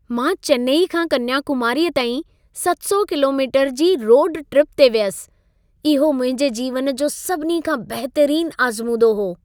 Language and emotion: Sindhi, happy